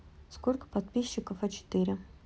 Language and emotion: Russian, neutral